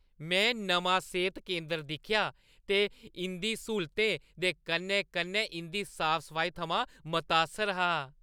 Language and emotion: Dogri, happy